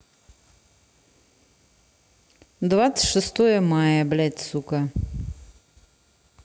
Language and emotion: Russian, angry